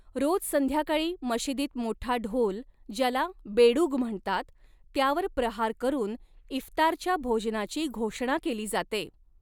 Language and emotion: Marathi, neutral